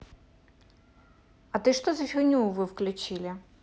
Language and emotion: Russian, neutral